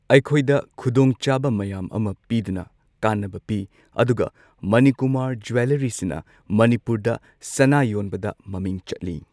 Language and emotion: Manipuri, neutral